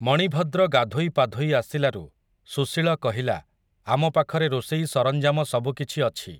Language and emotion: Odia, neutral